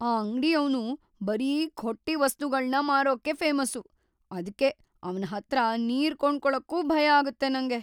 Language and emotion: Kannada, fearful